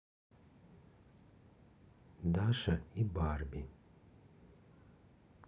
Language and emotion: Russian, neutral